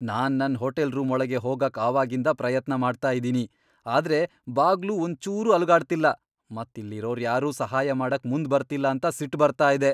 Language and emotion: Kannada, angry